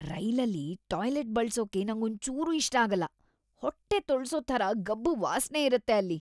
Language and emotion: Kannada, disgusted